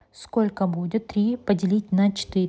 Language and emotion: Russian, neutral